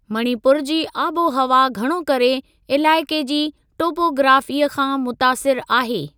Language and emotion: Sindhi, neutral